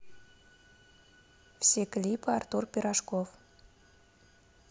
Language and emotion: Russian, neutral